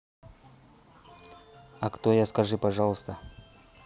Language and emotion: Russian, neutral